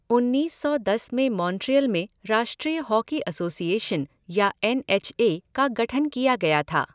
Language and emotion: Hindi, neutral